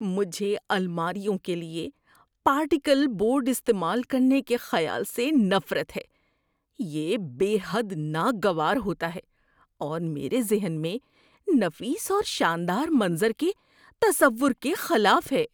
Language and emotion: Urdu, disgusted